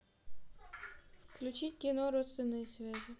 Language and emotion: Russian, neutral